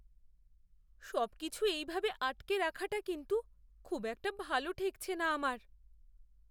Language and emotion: Bengali, fearful